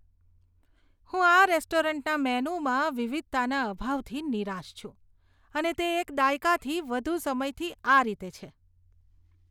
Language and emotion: Gujarati, disgusted